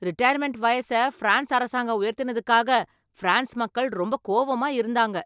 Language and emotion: Tamil, angry